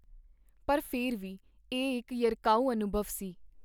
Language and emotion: Punjabi, neutral